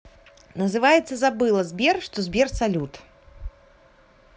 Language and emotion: Russian, positive